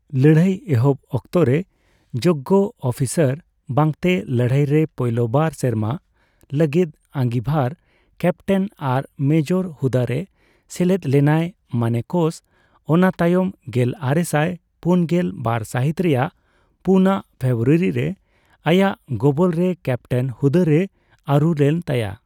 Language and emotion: Santali, neutral